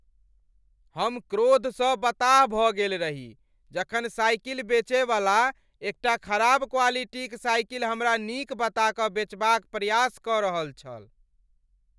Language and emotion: Maithili, angry